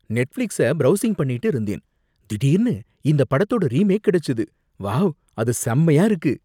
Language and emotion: Tamil, surprised